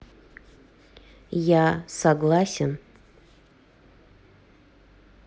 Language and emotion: Russian, neutral